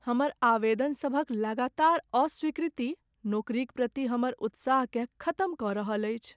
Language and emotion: Maithili, sad